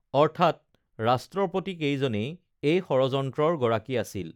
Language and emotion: Assamese, neutral